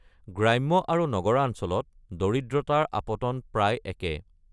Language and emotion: Assamese, neutral